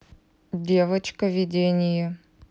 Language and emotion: Russian, neutral